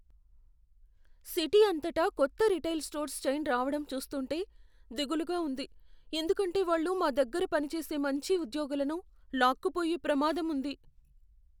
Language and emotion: Telugu, fearful